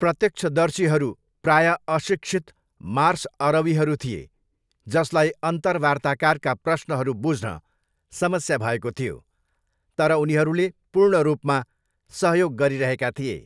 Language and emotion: Nepali, neutral